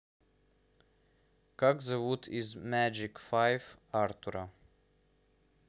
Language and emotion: Russian, neutral